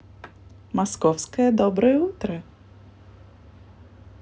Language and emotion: Russian, positive